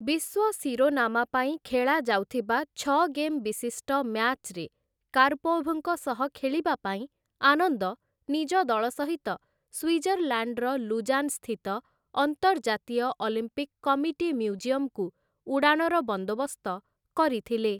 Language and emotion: Odia, neutral